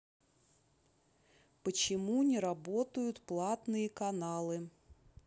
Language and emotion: Russian, neutral